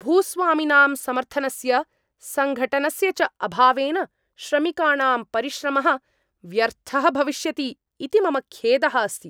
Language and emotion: Sanskrit, angry